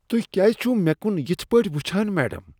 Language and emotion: Kashmiri, disgusted